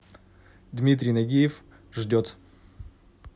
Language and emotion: Russian, neutral